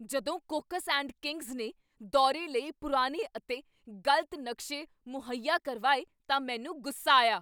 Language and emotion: Punjabi, angry